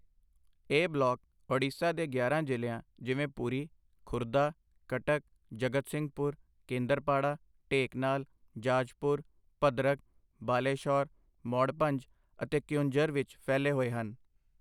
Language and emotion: Punjabi, neutral